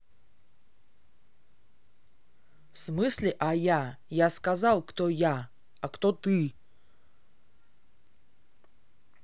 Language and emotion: Russian, angry